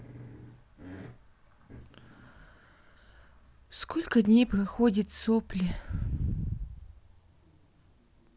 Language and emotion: Russian, sad